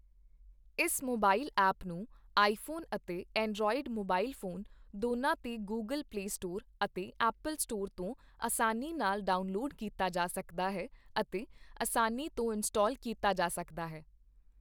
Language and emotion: Punjabi, neutral